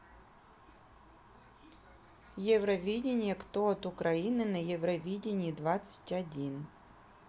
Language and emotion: Russian, neutral